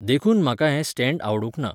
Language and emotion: Goan Konkani, neutral